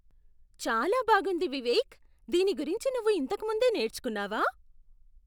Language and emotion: Telugu, surprised